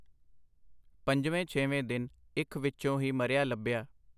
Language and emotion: Punjabi, neutral